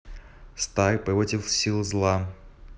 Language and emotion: Russian, neutral